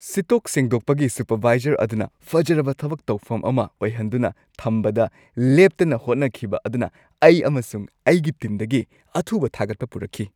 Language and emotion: Manipuri, happy